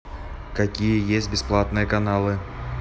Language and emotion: Russian, neutral